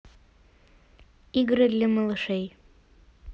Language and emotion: Russian, neutral